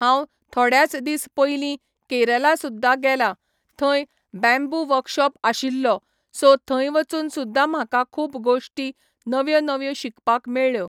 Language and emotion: Goan Konkani, neutral